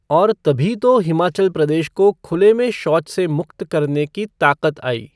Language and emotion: Hindi, neutral